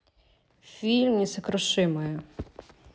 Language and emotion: Russian, neutral